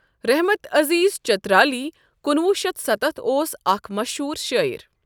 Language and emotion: Kashmiri, neutral